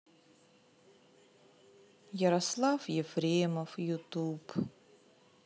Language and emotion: Russian, sad